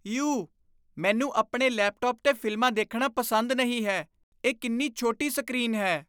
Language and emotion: Punjabi, disgusted